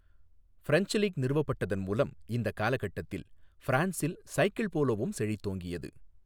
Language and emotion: Tamil, neutral